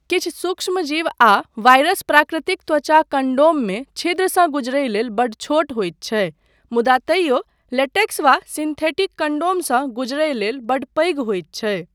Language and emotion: Maithili, neutral